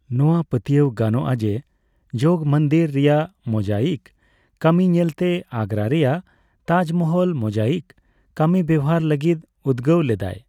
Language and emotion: Santali, neutral